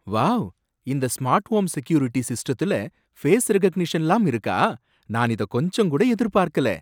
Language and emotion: Tamil, surprised